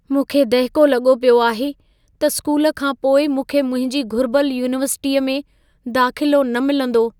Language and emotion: Sindhi, fearful